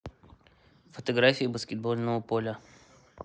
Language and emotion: Russian, neutral